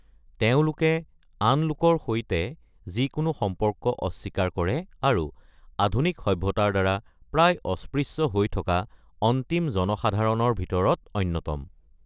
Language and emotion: Assamese, neutral